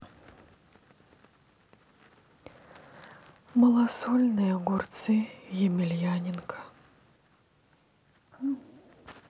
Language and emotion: Russian, sad